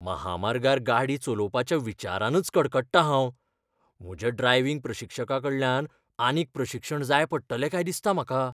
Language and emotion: Goan Konkani, fearful